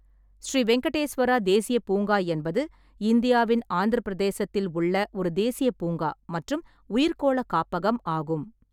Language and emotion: Tamil, neutral